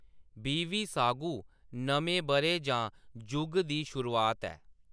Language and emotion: Dogri, neutral